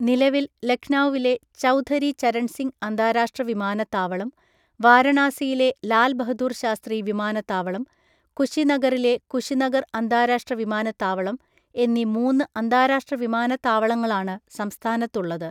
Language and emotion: Malayalam, neutral